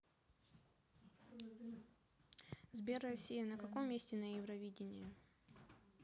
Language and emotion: Russian, neutral